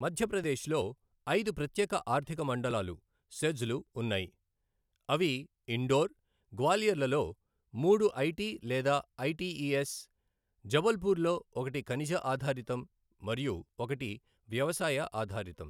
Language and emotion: Telugu, neutral